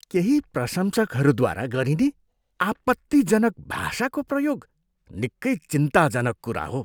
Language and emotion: Nepali, disgusted